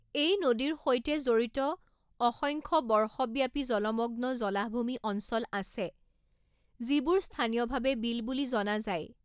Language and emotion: Assamese, neutral